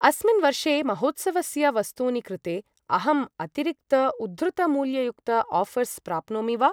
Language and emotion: Sanskrit, neutral